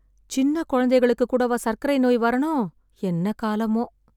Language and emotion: Tamil, sad